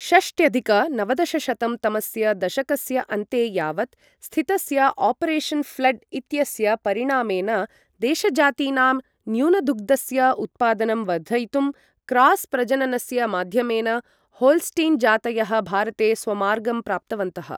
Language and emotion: Sanskrit, neutral